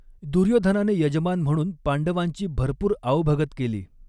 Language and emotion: Marathi, neutral